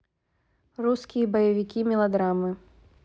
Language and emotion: Russian, neutral